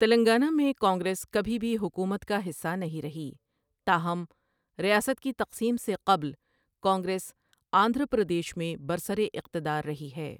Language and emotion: Urdu, neutral